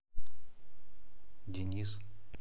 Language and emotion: Russian, neutral